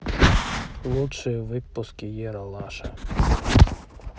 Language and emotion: Russian, neutral